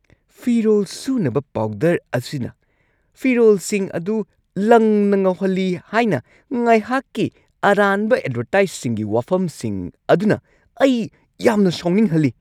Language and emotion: Manipuri, angry